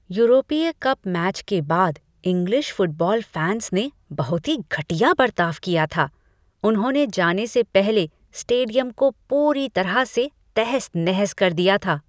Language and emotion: Hindi, disgusted